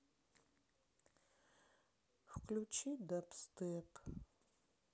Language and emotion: Russian, sad